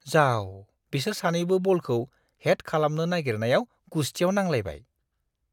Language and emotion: Bodo, disgusted